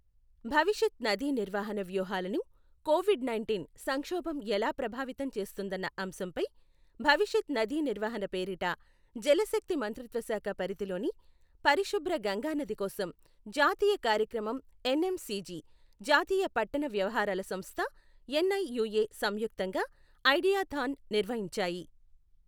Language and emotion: Telugu, neutral